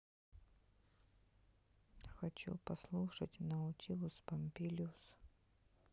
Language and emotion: Russian, sad